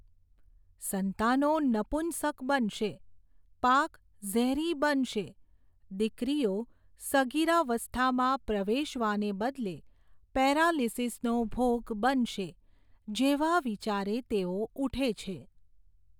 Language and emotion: Gujarati, neutral